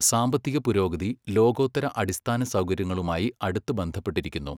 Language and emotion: Malayalam, neutral